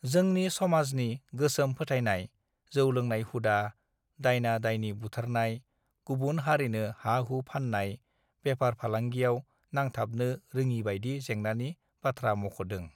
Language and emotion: Bodo, neutral